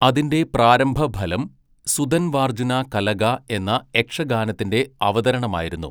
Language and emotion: Malayalam, neutral